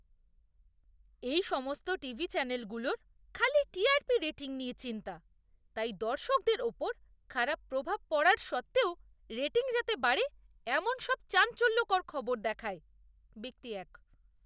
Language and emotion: Bengali, disgusted